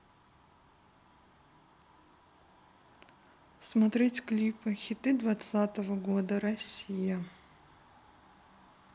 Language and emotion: Russian, neutral